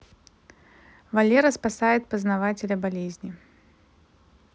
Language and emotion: Russian, neutral